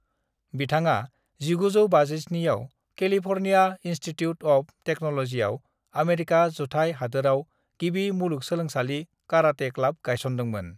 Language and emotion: Bodo, neutral